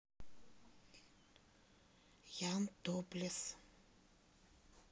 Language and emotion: Russian, neutral